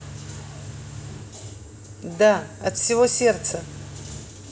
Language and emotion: Russian, neutral